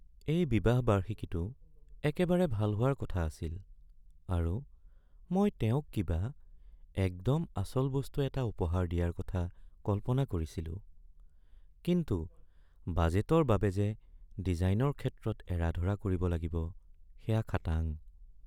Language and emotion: Assamese, sad